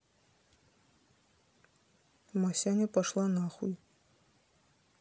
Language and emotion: Russian, neutral